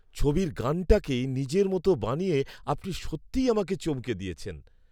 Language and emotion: Bengali, surprised